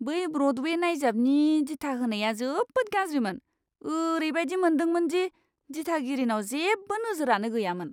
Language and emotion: Bodo, disgusted